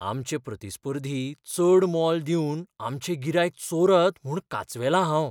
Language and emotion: Goan Konkani, fearful